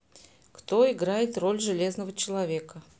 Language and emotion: Russian, neutral